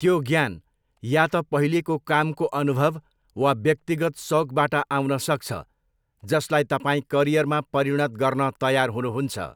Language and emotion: Nepali, neutral